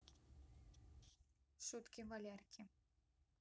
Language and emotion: Russian, neutral